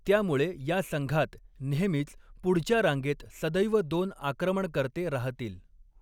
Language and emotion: Marathi, neutral